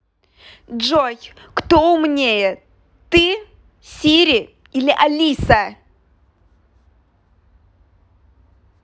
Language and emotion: Russian, angry